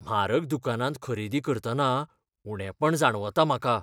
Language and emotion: Goan Konkani, fearful